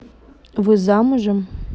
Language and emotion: Russian, neutral